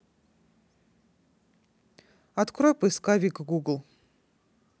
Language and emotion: Russian, neutral